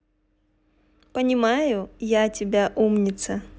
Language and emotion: Russian, neutral